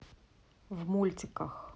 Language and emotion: Russian, neutral